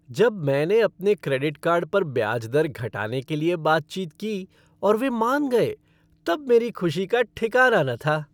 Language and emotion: Hindi, happy